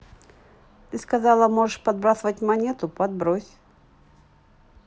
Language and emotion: Russian, neutral